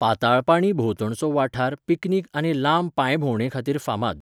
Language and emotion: Goan Konkani, neutral